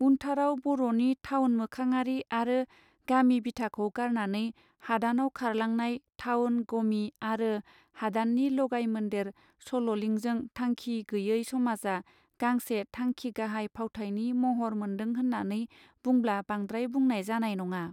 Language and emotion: Bodo, neutral